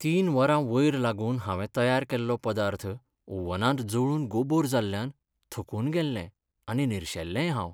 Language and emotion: Goan Konkani, sad